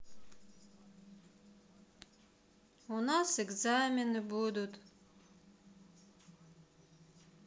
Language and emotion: Russian, sad